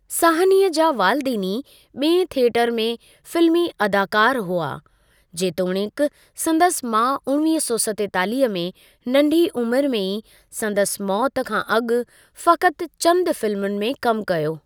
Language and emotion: Sindhi, neutral